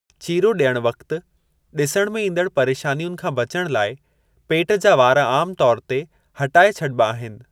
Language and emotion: Sindhi, neutral